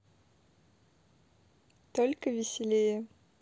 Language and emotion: Russian, positive